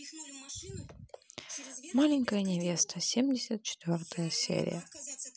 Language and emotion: Russian, sad